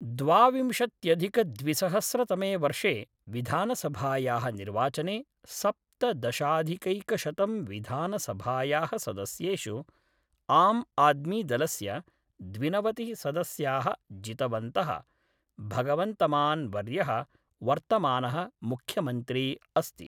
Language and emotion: Sanskrit, neutral